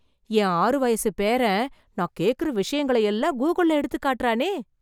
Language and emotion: Tamil, surprised